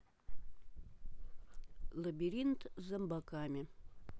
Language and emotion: Russian, neutral